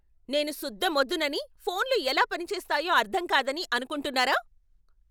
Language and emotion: Telugu, angry